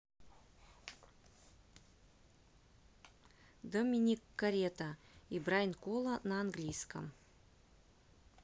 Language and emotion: Russian, neutral